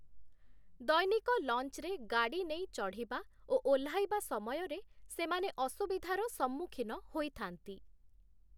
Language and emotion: Odia, neutral